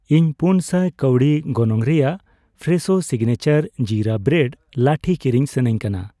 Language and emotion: Santali, neutral